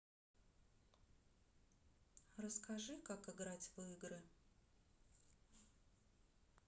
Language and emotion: Russian, neutral